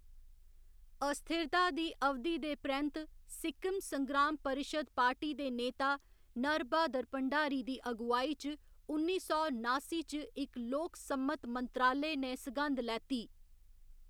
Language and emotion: Dogri, neutral